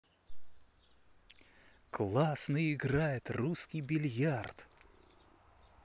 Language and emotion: Russian, positive